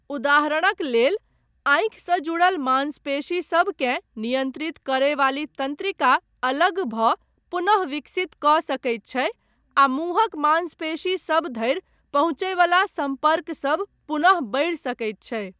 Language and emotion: Maithili, neutral